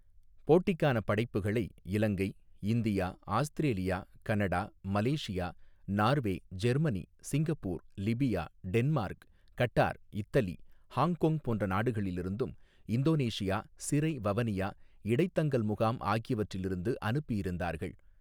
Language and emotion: Tamil, neutral